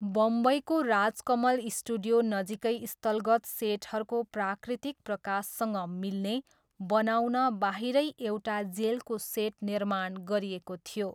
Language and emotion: Nepali, neutral